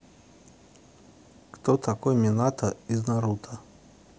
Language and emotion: Russian, neutral